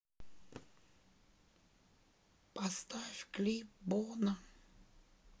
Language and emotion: Russian, sad